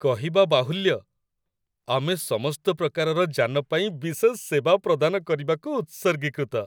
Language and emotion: Odia, happy